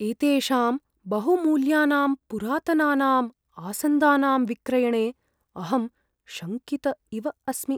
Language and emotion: Sanskrit, fearful